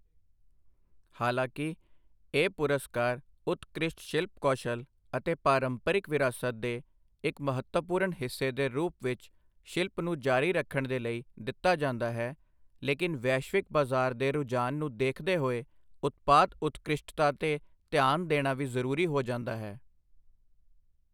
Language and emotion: Punjabi, neutral